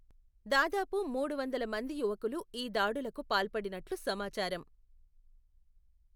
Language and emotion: Telugu, neutral